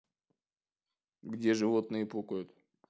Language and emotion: Russian, neutral